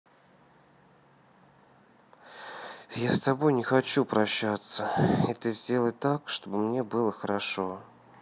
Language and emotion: Russian, sad